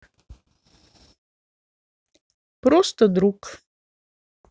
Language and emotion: Russian, neutral